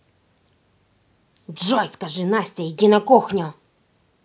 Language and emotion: Russian, angry